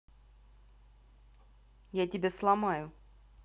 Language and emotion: Russian, angry